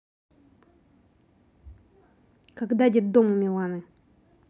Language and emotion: Russian, neutral